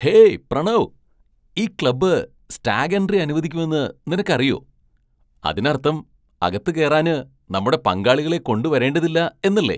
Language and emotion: Malayalam, surprised